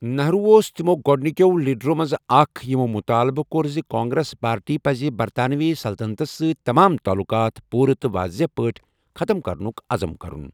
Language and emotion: Kashmiri, neutral